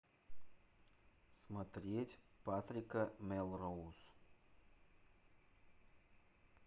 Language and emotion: Russian, neutral